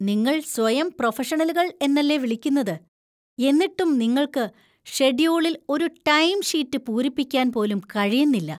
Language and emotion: Malayalam, disgusted